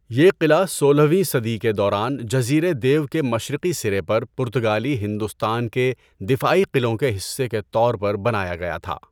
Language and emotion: Urdu, neutral